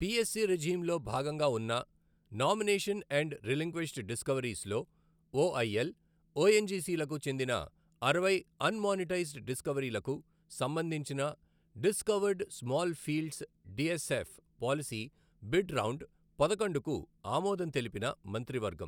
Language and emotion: Telugu, neutral